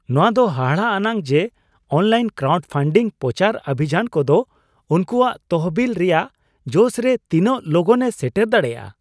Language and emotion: Santali, surprised